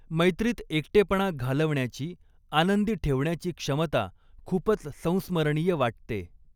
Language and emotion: Marathi, neutral